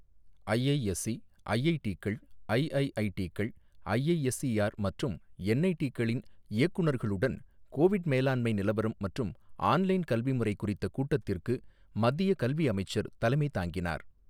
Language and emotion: Tamil, neutral